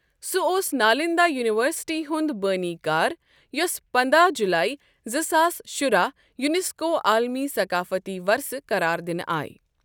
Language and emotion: Kashmiri, neutral